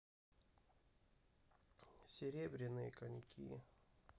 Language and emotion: Russian, sad